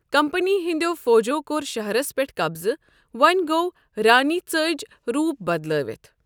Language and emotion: Kashmiri, neutral